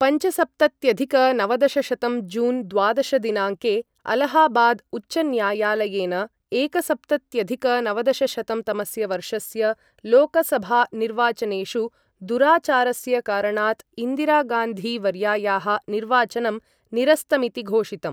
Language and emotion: Sanskrit, neutral